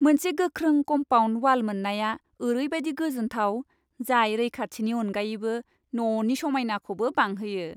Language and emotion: Bodo, happy